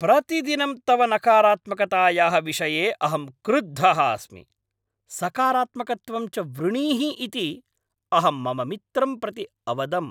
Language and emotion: Sanskrit, angry